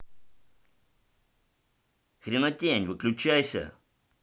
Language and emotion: Russian, angry